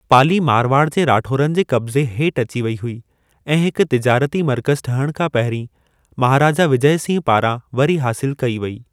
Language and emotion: Sindhi, neutral